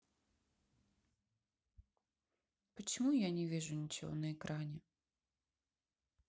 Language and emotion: Russian, sad